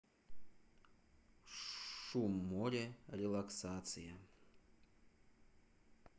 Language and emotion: Russian, neutral